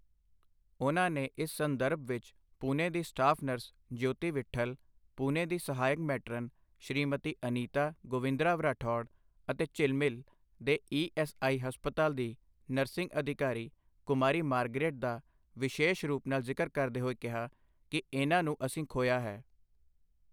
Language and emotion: Punjabi, neutral